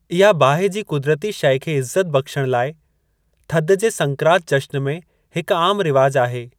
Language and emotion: Sindhi, neutral